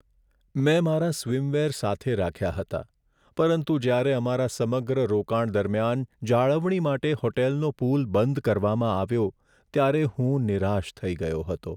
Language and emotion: Gujarati, sad